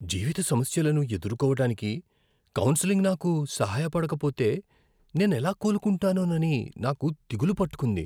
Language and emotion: Telugu, fearful